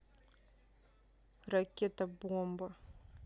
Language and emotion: Russian, neutral